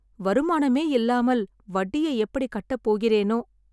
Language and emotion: Tamil, sad